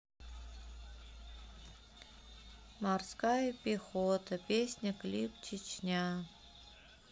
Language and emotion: Russian, sad